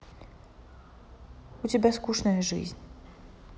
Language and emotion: Russian, sad